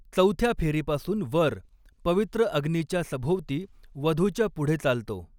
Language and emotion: Marathi, neutral